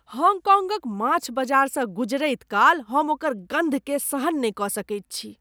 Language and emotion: Maithili, disgusted